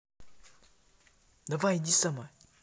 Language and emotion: Russian, neutral